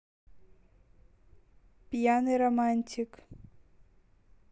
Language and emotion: Russian, neutral